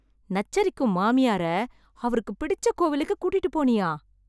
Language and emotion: Tamil, surprised